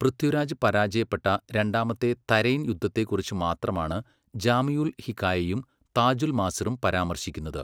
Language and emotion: Malayalam, neutral